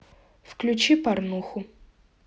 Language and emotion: Russian, neutral